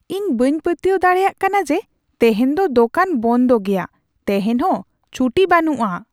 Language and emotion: Santali, surprised